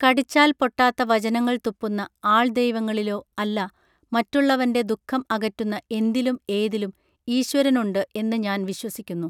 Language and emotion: Malayalam, neutral